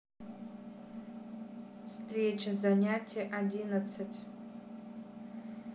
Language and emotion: Russian, neutral